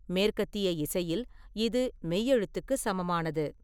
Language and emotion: Tamil, neutral